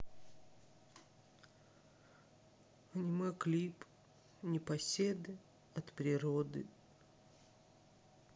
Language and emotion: Russian, sad